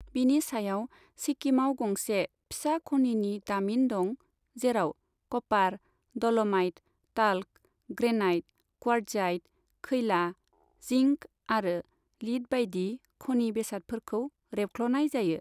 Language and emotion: Bodo, neutral